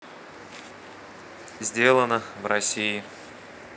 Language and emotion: Russian, neutral